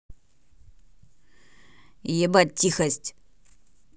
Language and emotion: Russian, angry